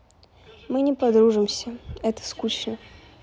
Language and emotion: Russian, neutral